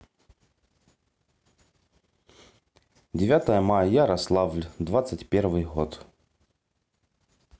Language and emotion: Russian, neutral